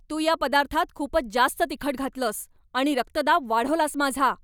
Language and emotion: Marathi, angry